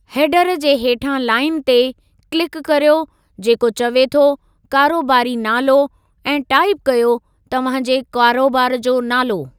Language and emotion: Sindhi, neutral